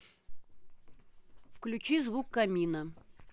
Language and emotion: Russian, neutral